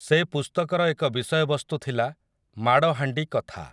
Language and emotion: Odia, neutral